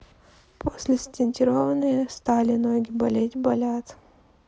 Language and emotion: Russian, sad